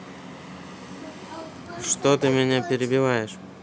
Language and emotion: Russian, neutral